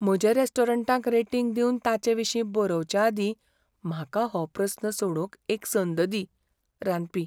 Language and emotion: Goan Konkani, fearful